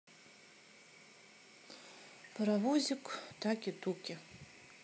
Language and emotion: Russian, sad